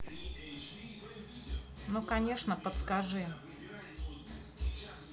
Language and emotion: Russian, neutral